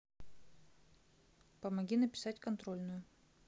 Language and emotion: Russian, neutral